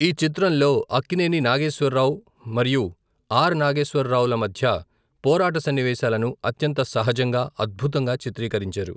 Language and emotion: Telugu, neutral